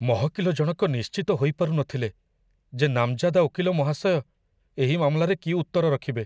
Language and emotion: Odia, fearful